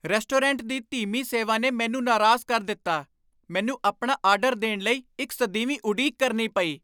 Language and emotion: Punjabi, angry